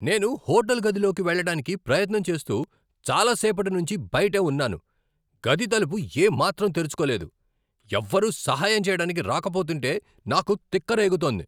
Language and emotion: Telugu, angry